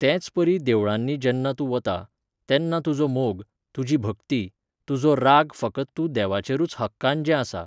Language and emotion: Goan Konkani, neutral